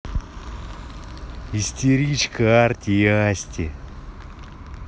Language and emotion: Russian, neutral